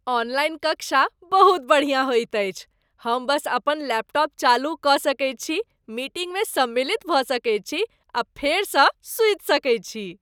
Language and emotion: Maithili, happy